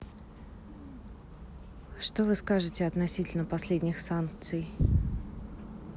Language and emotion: Russian, neutral